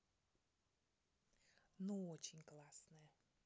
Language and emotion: Russian, positive